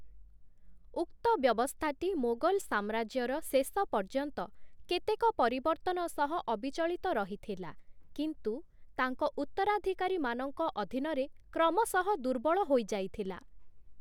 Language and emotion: Odia, neutral